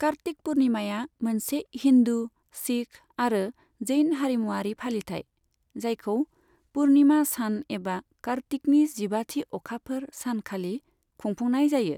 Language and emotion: Bodo, neutral